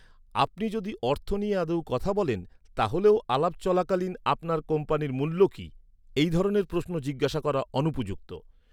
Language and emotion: Bengali, neutral